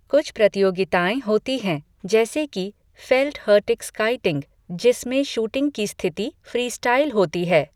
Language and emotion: Hindi, neutral